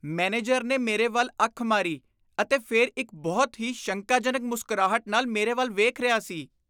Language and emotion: Punjabi, disgusted